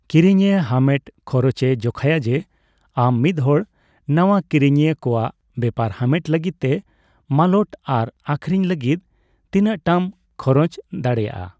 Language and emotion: Santali, neutral